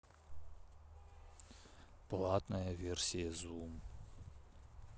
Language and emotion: Russian, sad